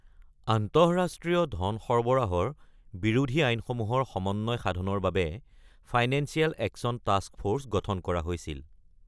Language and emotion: Assamese, neutral